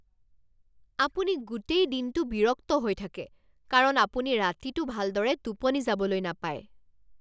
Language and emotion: Assamese, angry